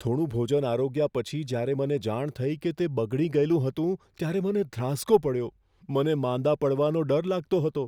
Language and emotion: Gujarati, fearful